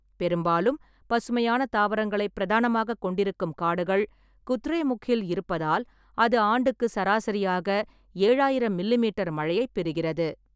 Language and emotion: Tamil, neutral